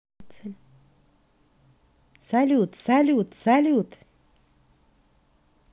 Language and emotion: Russian, positive